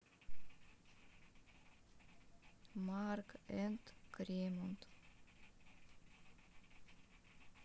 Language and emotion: Russian, sad